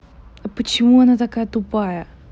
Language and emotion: Russian, angry